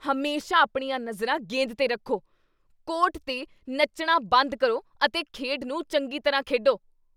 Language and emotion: Punjabi, angry